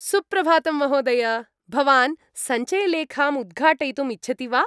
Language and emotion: Sanskrit, happy